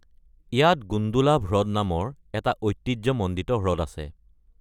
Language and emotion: Assamese, neutral